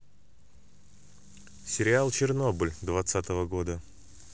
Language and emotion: Russian, neutral